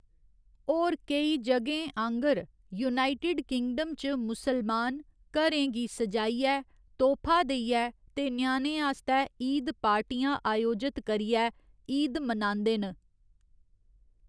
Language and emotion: Dogri, neutral